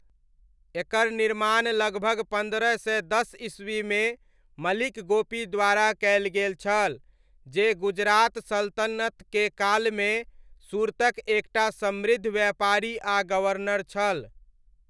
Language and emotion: Maithili, neutral